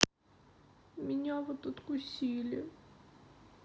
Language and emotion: Russian, sad